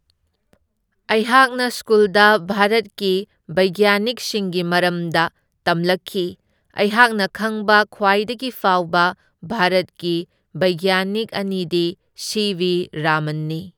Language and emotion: Manipuri, neutral